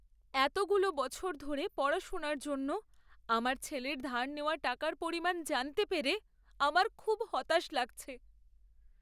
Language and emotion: Bengali, sad